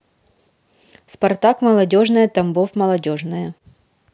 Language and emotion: Russian, neutral